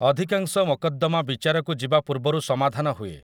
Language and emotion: Odia, neutral